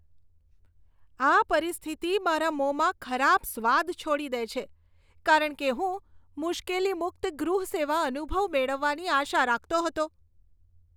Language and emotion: Gujarati, disgusted